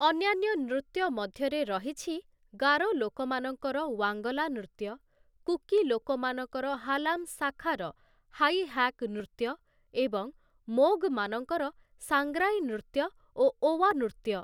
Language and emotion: Odia, neutral